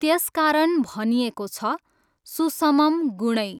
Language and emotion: Nepali, neutral